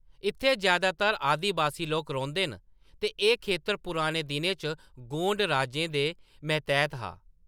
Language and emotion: Dogri, neutral